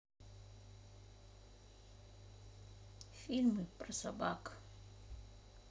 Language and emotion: Russian, sad